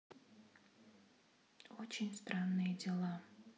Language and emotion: Russian, sad